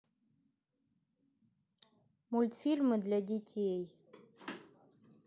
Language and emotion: Russian, neutral